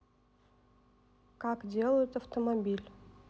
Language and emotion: Russian, neutral